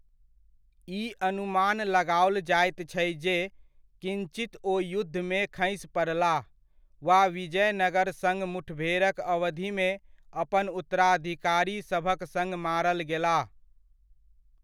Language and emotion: Maithili, neutral